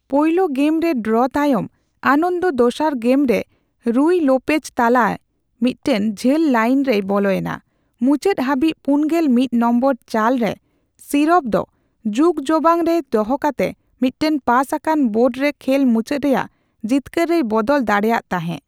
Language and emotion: Santali, neutral